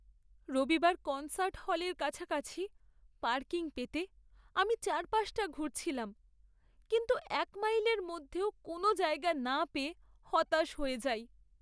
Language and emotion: Bengali, sad